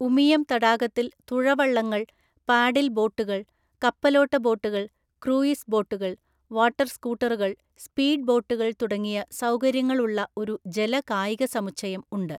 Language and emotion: Malayalam, neutral